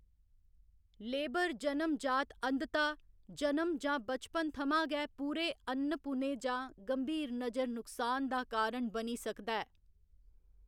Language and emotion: Dogri, neutral